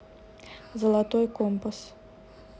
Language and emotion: Russian, neutral